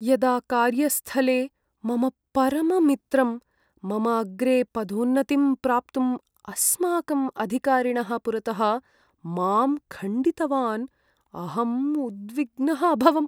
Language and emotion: Sanskrit, sad